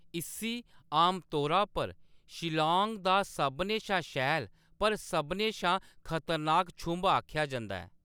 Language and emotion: Dogri, neutral